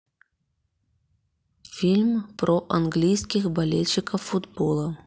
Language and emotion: Russian, neutral